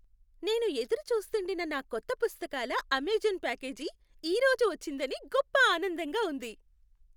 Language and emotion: Telugu, happy